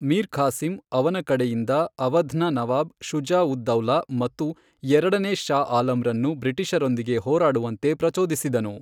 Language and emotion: Kannada, neutral